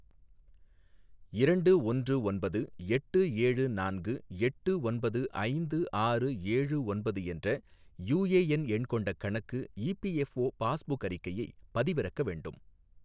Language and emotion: Tamil, neutral